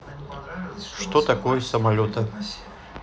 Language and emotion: Russian, neutral